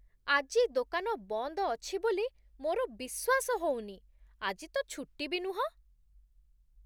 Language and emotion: Odia, surprised